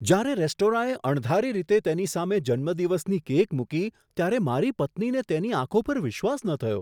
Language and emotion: Gujarati, surprised